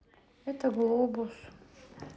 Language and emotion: Russian, sad